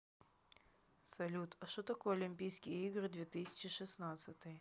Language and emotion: Russian, neutral